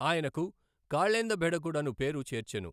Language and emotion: Telugu, neutral